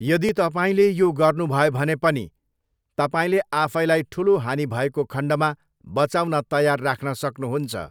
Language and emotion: Nepali, neutral